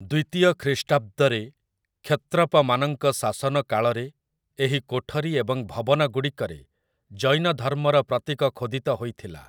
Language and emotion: Odia, neutral